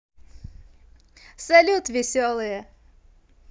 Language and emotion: Russian, positive